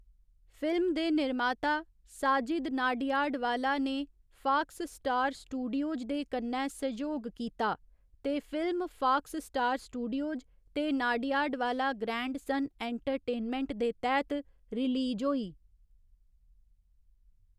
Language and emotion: Dogri, neutral